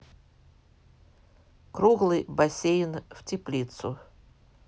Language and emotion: Russian, neutral